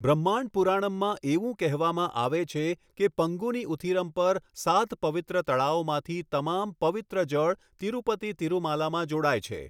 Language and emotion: Gujarati, neutral